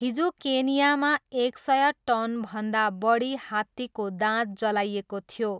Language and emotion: Nepali, neutral